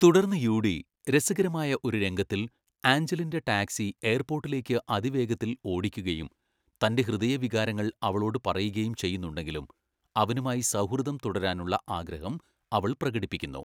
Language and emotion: Malayalam, neutral